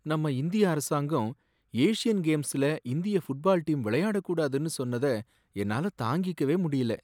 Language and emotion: Tamil, sad